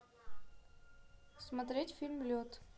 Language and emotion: Russian, neutral